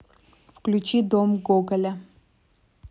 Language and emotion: Russian, neutral